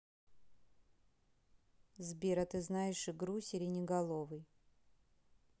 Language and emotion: Russian, neutral